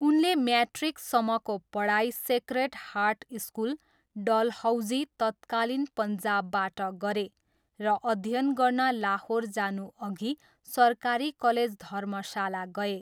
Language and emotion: Nepali, neutral